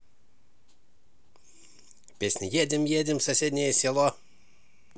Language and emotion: Russian, positive